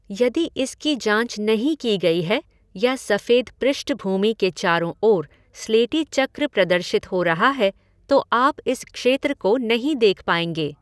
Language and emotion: Hindi, neutral